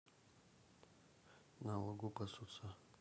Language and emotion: Russian, neutral